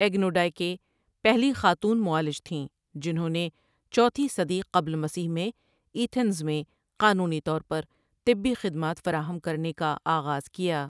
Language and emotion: Urdu, neutral